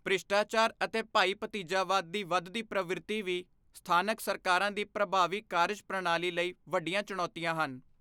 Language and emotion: Punjabi, neutral